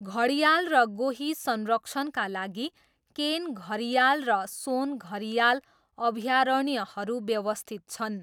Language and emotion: Nepali, neutral